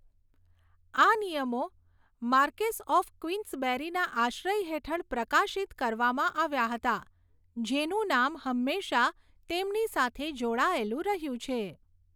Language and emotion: Gujarati, neutral